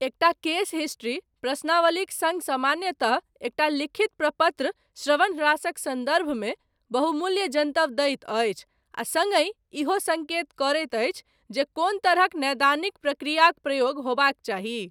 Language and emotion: Maithili, neutral